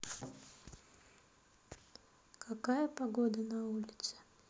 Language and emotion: Russian, sad